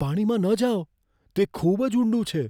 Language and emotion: Gujarati, fearful